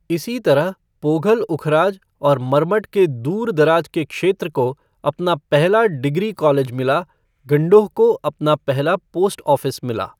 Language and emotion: Hindi, neutral